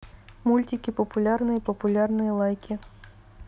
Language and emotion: Russian, neutral